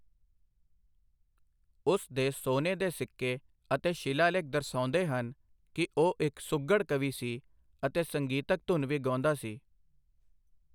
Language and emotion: Punjabi, neutral